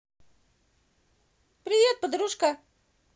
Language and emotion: Russian, positive